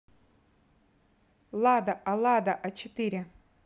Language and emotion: Russian, neutral